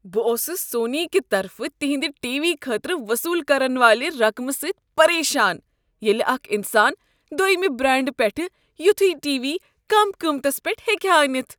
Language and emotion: Kashmiri, disgusted